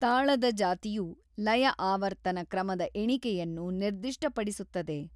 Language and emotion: Kannada, neutral